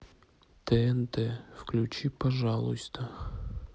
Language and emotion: Russian, neutral